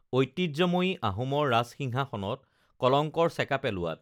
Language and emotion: Assamese, neutral